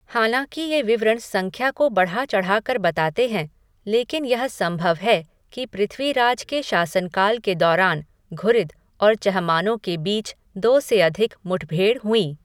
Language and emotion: Hindi, neutral